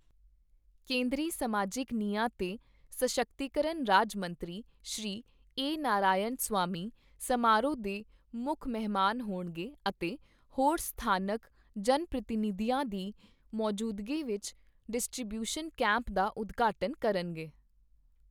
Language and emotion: Punjabi, neutral